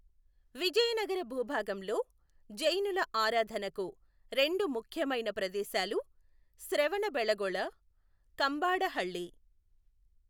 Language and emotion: Telugu, neutral